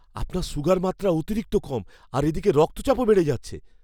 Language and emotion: Bengali, fearful